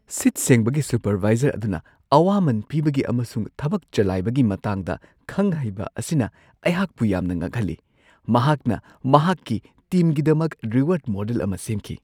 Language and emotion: Manipuri, surprised